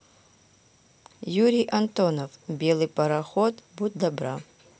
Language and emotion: Russian, neutral